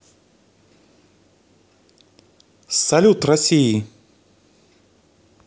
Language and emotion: Russian, positive